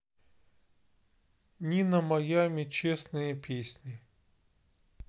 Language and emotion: Russian, neutral